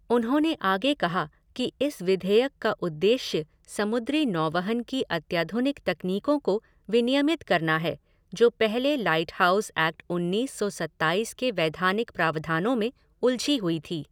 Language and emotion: Hindi, neutral